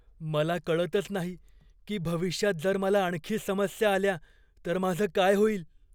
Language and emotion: Marathi, fearful